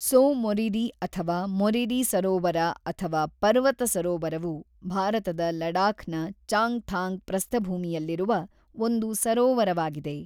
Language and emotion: Kannada, neutral